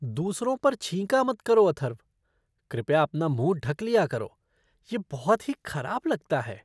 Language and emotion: Hindi, disgusted